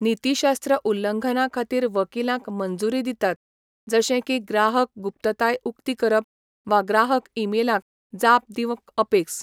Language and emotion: Goan Konkani, neutral